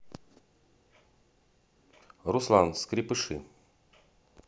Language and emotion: Russian, neutral